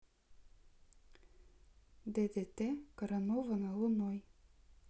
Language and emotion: Russian, neutral